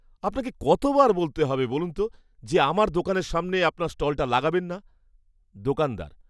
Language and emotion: Bengali, angry